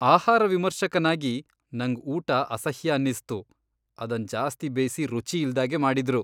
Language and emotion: Kannada, disgusted